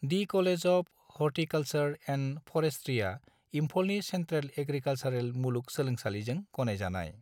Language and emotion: Bodo, neutral